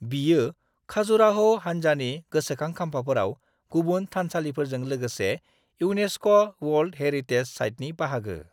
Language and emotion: Bodo, neutral